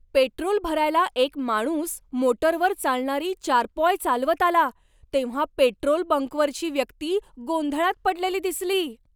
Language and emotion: Marathi, surprised